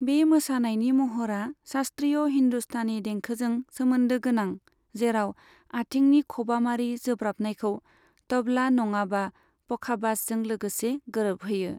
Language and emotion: Bodo, neutral